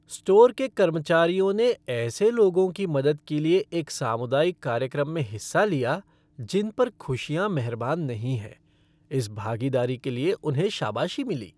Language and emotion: Hindi, happy